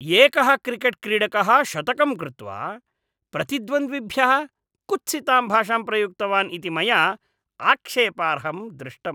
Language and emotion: Sanskrit, disgusted